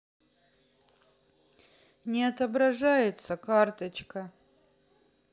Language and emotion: Russian, sad